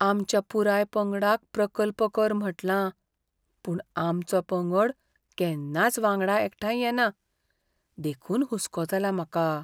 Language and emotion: Goan Konkani, fearful